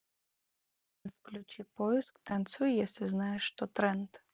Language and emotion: Russian, neutral